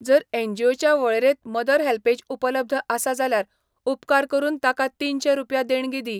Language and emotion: Goan Konkani, neutral